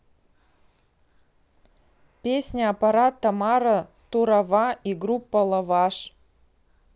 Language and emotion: Russian, neutral